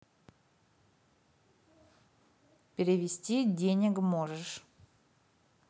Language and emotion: Russian, neutral